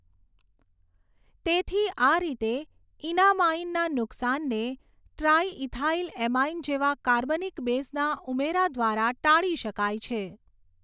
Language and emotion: Gujarati, neutral